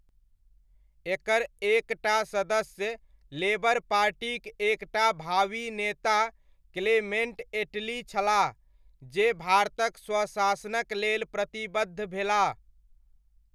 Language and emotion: Maithili, neutral